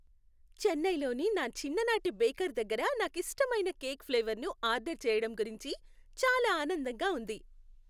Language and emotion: Telugu, happy